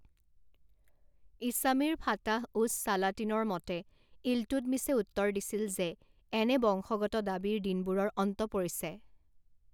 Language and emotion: Assamese, neutral